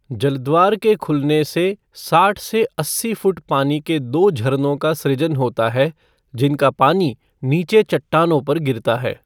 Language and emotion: Hindi, neutral